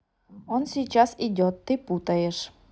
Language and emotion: Russian, neutral